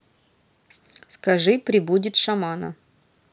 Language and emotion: Russian, neutral